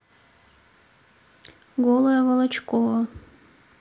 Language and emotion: Russian, neutral